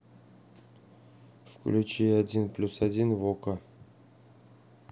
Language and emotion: Russian, neutral